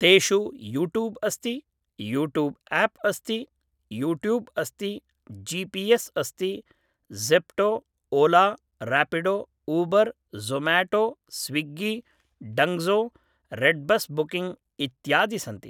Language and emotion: Sanskrit, neutral